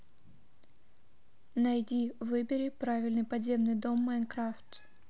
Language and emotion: Russian, neutral